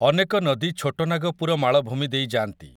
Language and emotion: Odia, neutral